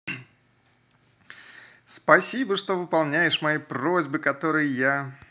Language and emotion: Russian, positive